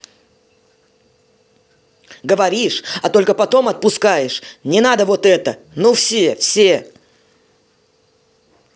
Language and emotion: Russian, angry